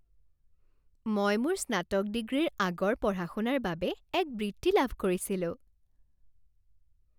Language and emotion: Assamese, happy